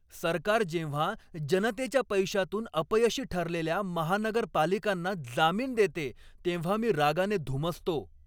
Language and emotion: Marathi, angry